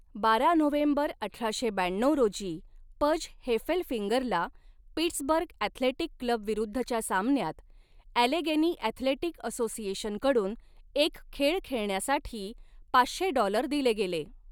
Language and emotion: Marathi, neutral